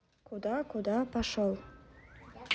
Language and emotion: Russian, neutral